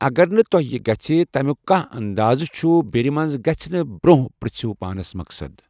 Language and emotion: Kashmiri, neutral